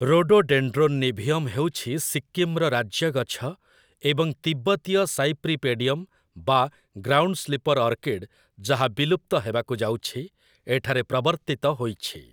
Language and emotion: Odia, neutral